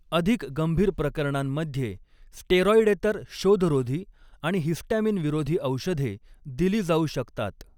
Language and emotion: Marathi, neutral